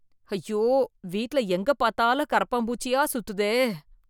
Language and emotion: Tamil, disgusted